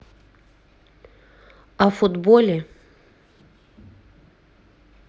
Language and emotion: Russian, neutral